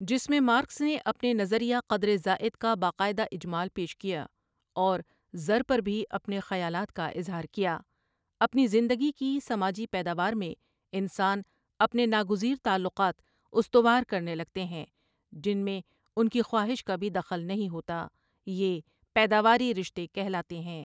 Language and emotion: Urdu, neutral